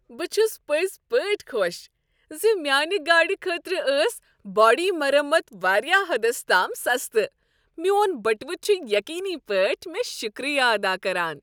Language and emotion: Kashmiri, happy